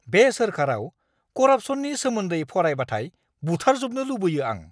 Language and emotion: Bodo, angry